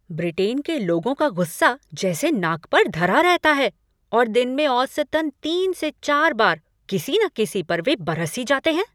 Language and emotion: Hindi, angry